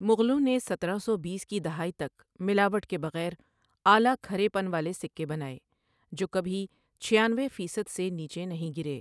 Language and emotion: Urdu, neutral